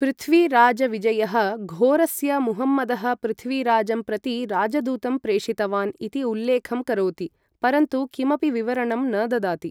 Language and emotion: Sanskrit, neutral